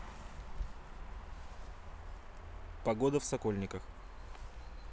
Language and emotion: Russian, neutral